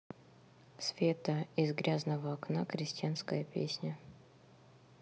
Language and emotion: Russian, neutral